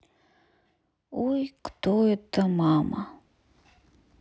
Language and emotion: Russian, sad